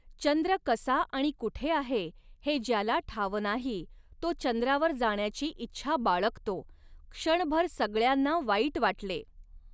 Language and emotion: Marathi, neutral